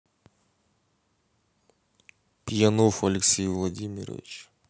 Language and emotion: Russian, neutral